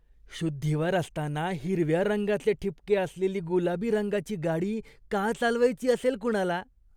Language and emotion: Marathi, disgusted